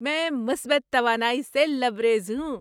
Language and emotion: Urdu, happy